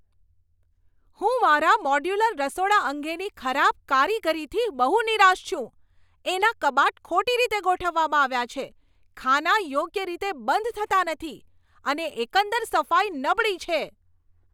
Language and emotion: Gujarati, angry